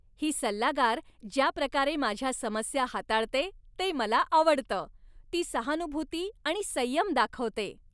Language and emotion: Marathi, happy